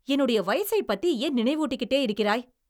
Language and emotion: Tamil, angry